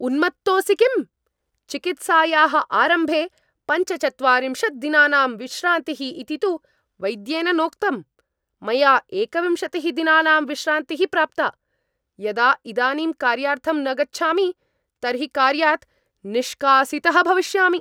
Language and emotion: Sanskrit, angry